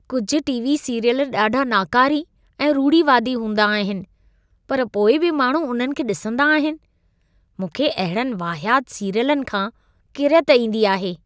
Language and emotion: Sindhi, disgusted